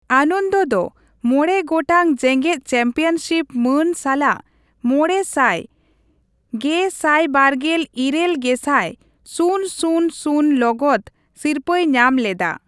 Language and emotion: Santali, neutral